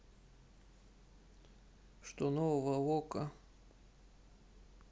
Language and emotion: Russian, neutral